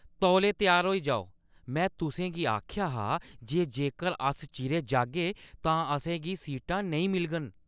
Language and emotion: Dogri, angry